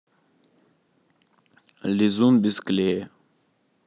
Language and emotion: Russian, neutral